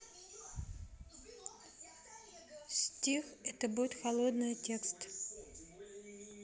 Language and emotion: Russian, neutral